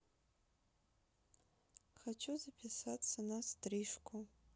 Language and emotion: Russian, neutral